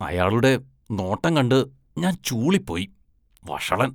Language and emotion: Malayalam, disgusted